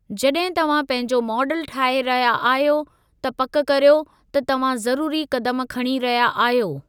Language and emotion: Sindhi, neutral